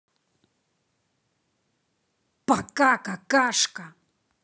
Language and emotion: Russian, angry